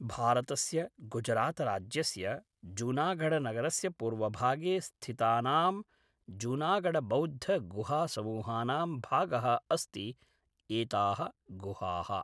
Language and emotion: Sanskrit, neutral